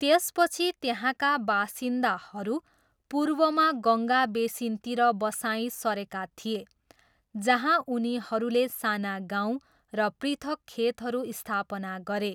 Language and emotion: Nepali, neutral